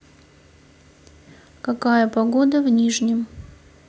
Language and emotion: Russian, neutral